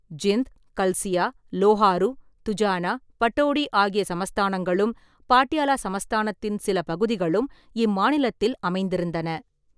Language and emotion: Tamil, neutral